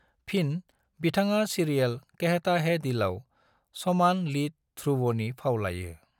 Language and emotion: Bodo, neutral